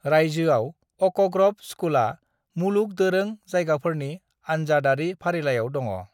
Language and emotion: Bodo, neutral